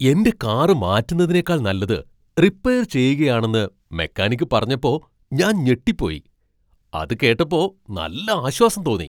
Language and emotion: Malayalam, surprised